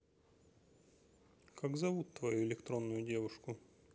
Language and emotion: Russian, neutral